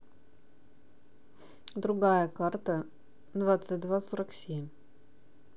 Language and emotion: Russian, neutral